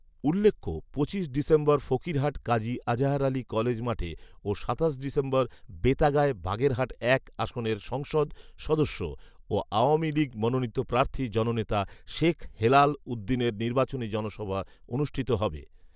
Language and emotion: Bengali, neutral